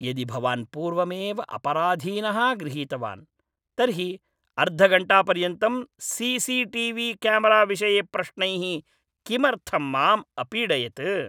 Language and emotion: Sanskrit, angry